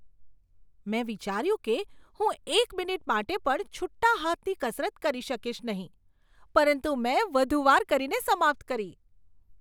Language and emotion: Gujarati, surprised